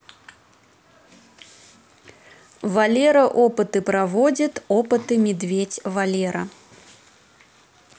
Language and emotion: Russian, neutral